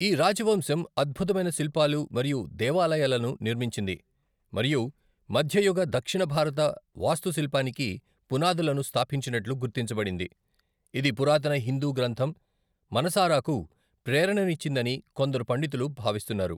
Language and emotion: Telugu, neutral